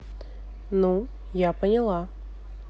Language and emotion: Russian, neutral